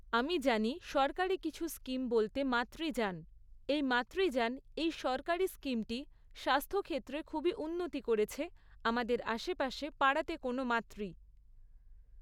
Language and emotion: Bengali, neutral